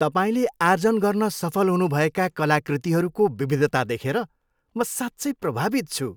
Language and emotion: Nepali, happy